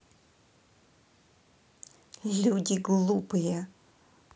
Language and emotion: Russian, angry